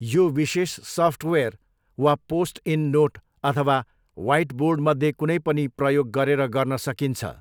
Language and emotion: Nepali, neutral